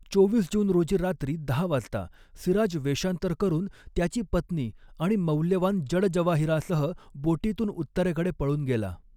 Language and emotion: Marathi, neutral